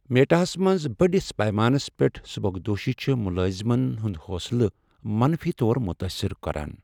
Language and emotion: Kashmiri, sad